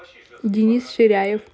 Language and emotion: Russian, positive